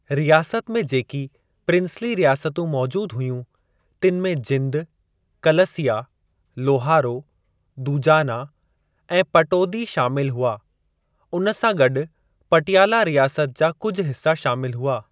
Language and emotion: Sindhi, neutral